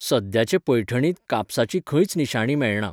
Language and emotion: Goan Konkani, neutral